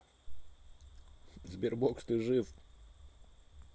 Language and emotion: Russian, neutral